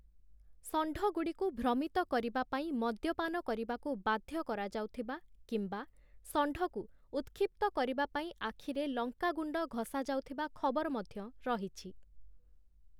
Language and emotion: Odia, neutral